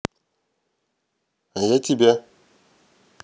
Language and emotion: Russian, neutral